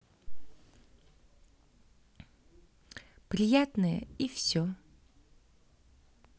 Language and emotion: Russian, neutral